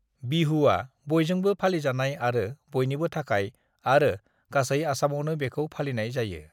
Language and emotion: Bodo, neutral